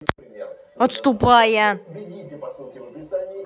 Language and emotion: Russian, angry